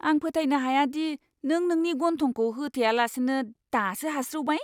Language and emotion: Bodo, disgusted